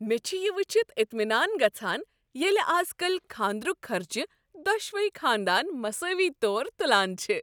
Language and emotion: Kashmiri, happy